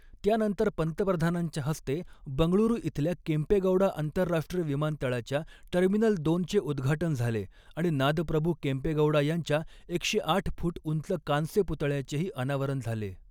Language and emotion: Marathi, neutral